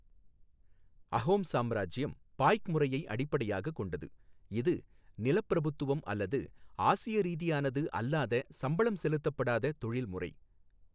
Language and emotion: Tamil, neutral